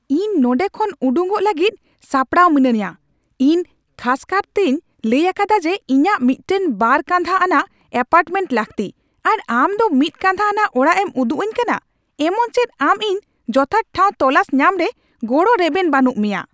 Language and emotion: Santali, angry